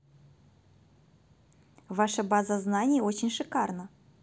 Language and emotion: Russian, positive